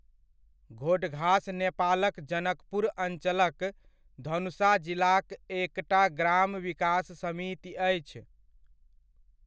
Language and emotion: Maithili, neutral